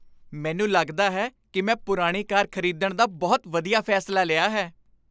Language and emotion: Punjabi, happy